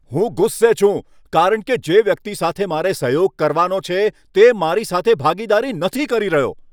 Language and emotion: Gujarati, angry